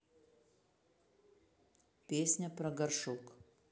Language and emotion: Russian, neutral